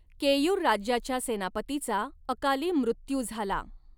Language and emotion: Marathi, neutral